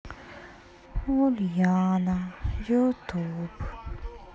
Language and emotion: Russian, sad